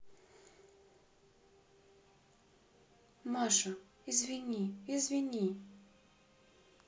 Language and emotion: Russian, sad